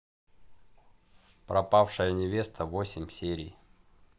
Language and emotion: Russian, neutral